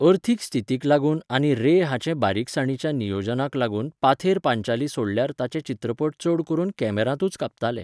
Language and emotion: Goan Konkani, neutral